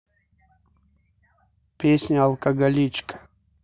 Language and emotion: Russian, neutral